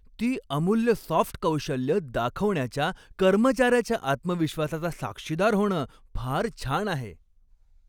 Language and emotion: Marathi, happy